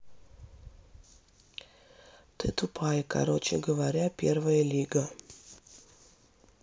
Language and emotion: Russian, neutral